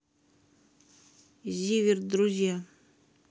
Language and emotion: Russian, neutral